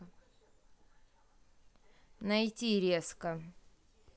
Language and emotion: Russian, neutral